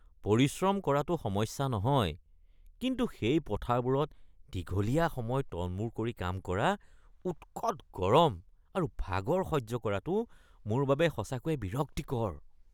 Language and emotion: Assamese, disgusted